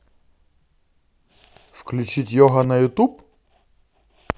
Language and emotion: Russian, positive